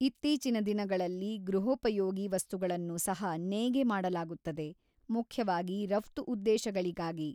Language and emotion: Kannada, neutral